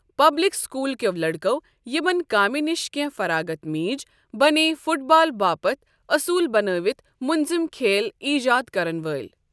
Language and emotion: Kashmiri, neutral